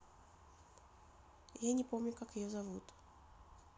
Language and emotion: Russian, neutral